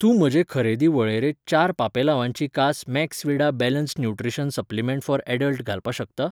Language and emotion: Goan Konkani, neutral